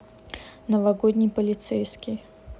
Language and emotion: Russian, neutral